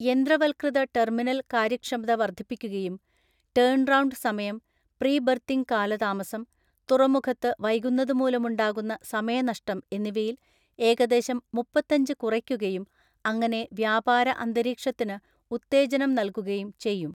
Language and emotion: Malayalam, neutral